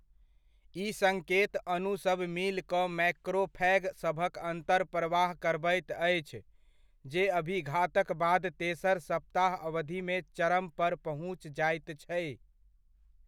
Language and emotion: Maithili, neutral